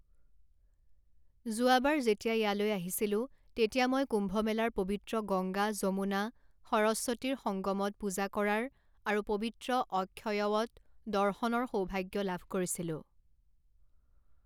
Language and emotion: Assamese, neutral